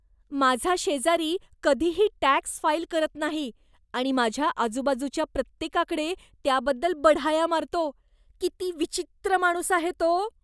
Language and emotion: Marathi, disgusted